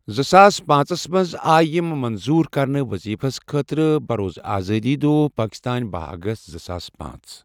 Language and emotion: Kashmiri, neutral